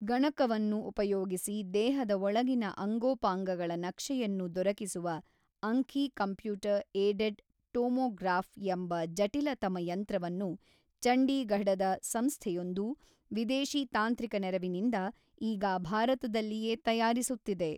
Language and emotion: Kannada, neutral